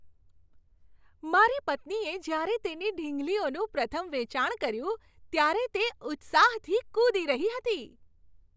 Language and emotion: Gujarati, happy